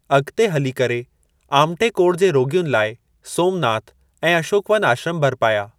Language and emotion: Sindhi, neutral